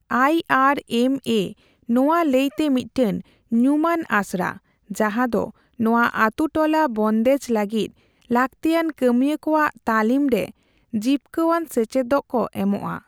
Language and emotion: Santali, neutral